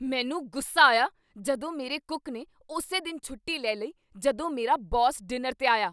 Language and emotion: Punjabi, angry